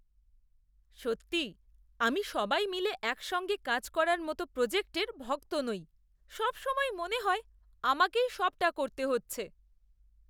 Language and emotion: Bengali, disgusted